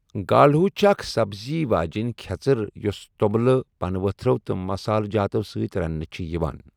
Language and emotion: Kashmiri, neutral